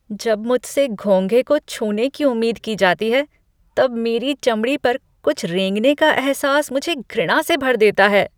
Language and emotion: Hindi, disgusted